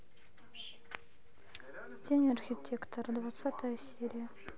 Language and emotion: Russian, neutral